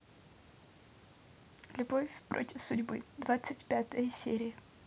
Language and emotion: Russian, neutral